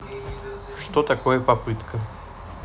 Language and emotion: Russian, neutral